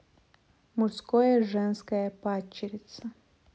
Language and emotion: Russian, neutral